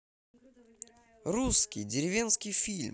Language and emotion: Russian, positive